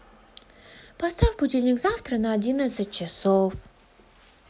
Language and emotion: Russian, positive